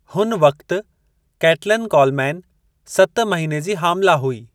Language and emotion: Sindhi, neutral